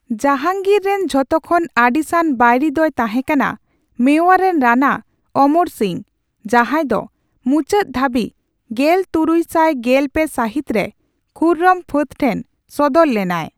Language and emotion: Santali, neutral